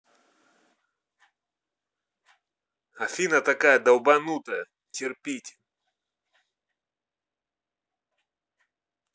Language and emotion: Russian, angry